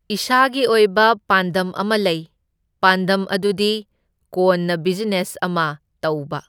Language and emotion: Manipuri, neutral